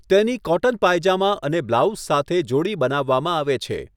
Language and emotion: Gujarati, neutral